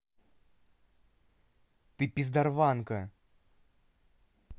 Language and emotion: Russian, angry